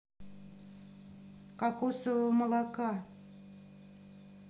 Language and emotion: Russian, neutral